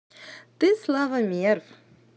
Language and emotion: Russian, positive